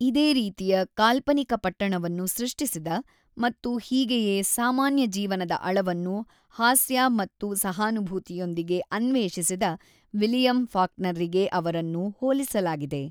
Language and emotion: Kannada, neutral